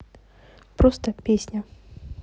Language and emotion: Russian, neutral